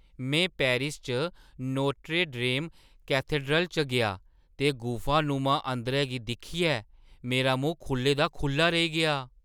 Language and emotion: Dogri, surprised